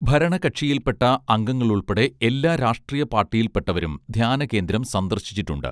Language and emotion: Malayalam, neutral